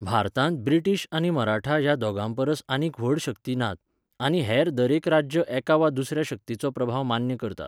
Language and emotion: Goan Konkani, neutral